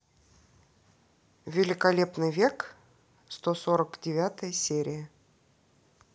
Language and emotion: Russian, neutral